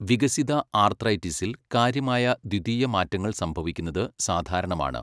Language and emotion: Malayalam, neutral